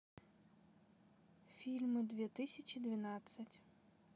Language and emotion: Russian, neutral